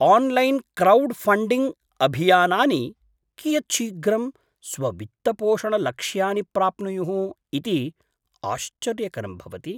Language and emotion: Sanskrit, surprised